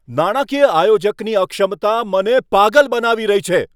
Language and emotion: Gujarati, angry